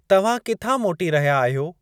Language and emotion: Sindhi, neutral